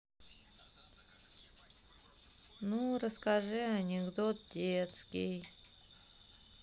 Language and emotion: Russian, sad